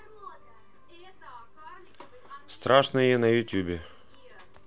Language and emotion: Russian, neutral